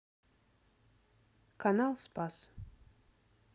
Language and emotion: Russian, neutral